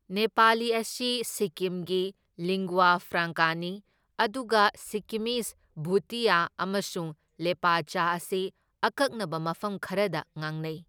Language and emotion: Manipuri, neutral